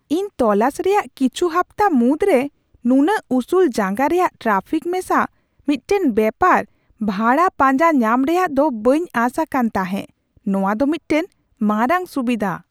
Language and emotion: Santali, surprised